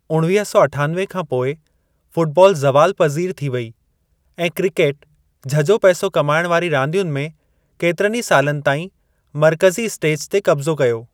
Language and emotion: Sindhi, neutral